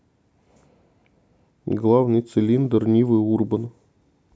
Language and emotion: Russian, neutral